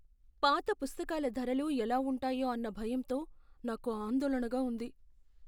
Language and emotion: Telugu, fearful